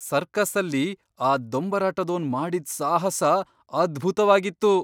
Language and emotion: Kannada, surprised